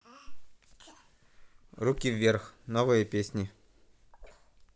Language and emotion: Russian, neutral